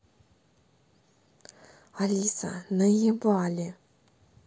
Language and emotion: Russian, neutral